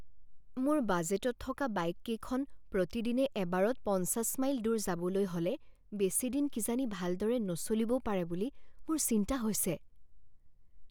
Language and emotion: Assamese, fearful